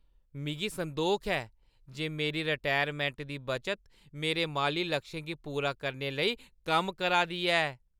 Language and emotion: Dogri, happy